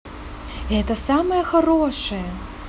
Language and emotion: Russian, positive